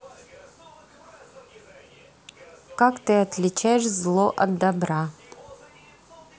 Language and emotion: Russian, neutral